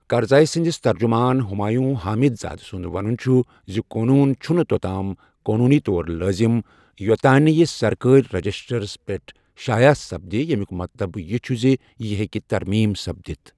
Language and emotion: Kashmiri, neutral